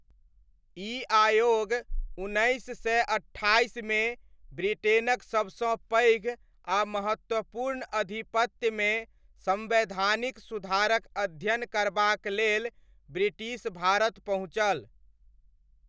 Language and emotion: Maithili, neutral